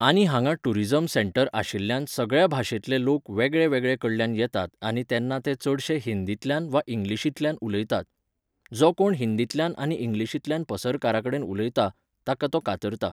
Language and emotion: Goan Konkani, neutral